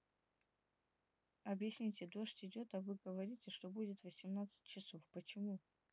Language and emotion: Russian, neutral